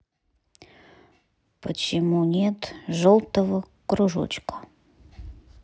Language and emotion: Russian, neutral